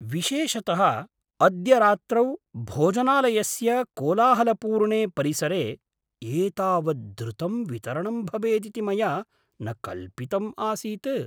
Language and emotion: Sanskrit, surprised